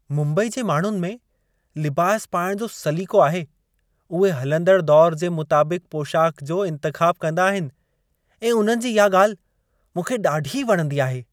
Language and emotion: Sindhi, happy